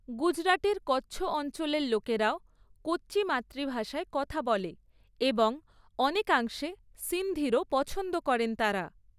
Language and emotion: Bengali, neutral